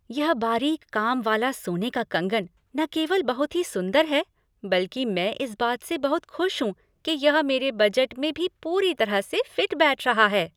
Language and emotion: Hindi, happy